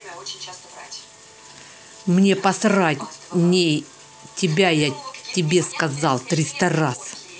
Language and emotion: Russian, angry